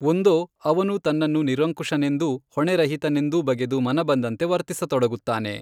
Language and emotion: Kannada, neutral